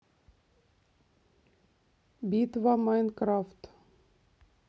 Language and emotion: Russian, neutral